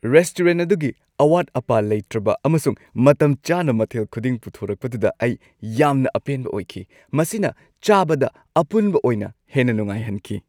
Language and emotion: Manipuri, happy